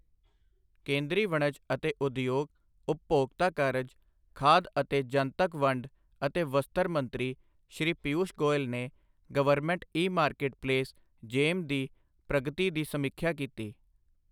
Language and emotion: Punjabi, neutral